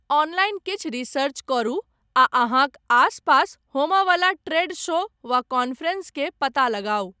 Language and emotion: Maithili, neutral